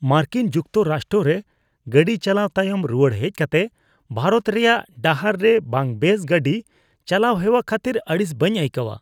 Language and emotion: Santali, disgusted